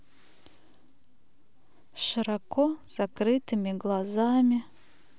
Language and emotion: Russian, sad